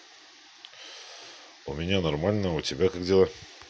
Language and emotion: Russian, neutral